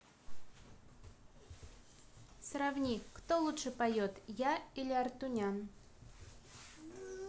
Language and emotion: Russian, neutral